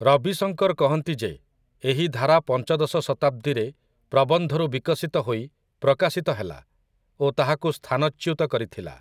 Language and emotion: Odia, neutral